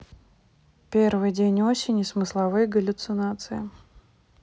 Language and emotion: Russian, neutral